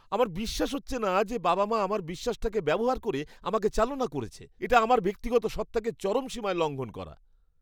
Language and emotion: Bengali, disgusted